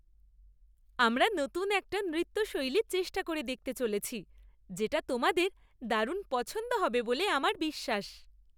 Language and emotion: Bengali, happy